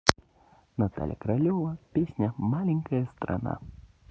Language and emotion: Russian, positive